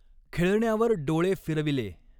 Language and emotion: Marathi, neutral